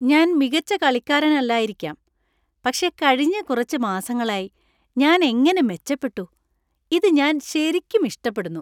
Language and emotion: Malayalam, happy